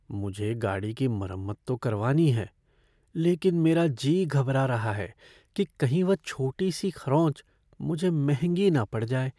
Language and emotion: Hindi, fearful